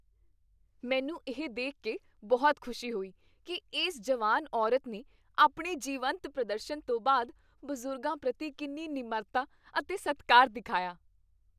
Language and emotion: Punjabi, happy